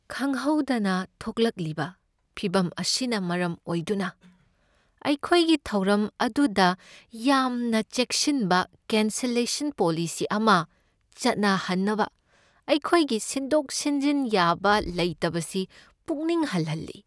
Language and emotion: Manipuri, sad